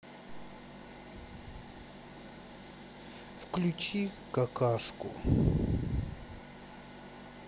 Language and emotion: Russian, neutral